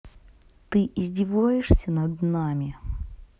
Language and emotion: Russian, angry